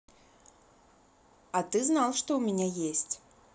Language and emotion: Russian, neutral